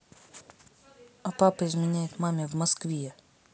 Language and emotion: Russian, neutral